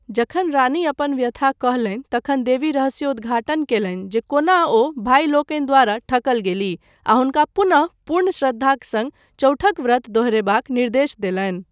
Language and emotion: Maithili, neutral